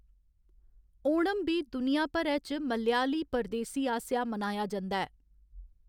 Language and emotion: Dogri, neutral